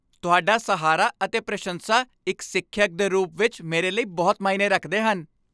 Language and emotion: Punjabi, happy